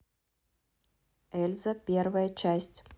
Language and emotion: Russian, neutral